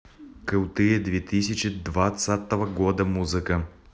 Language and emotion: Russian, neutral